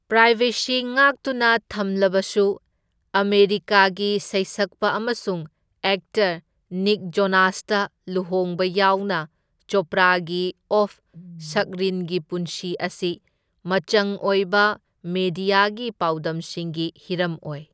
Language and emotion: Manipuri, neutral